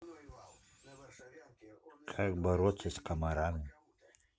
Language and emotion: Russian, neutral